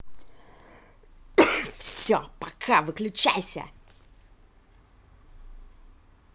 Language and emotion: Russian, angry